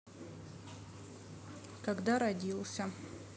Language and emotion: Russian, neutral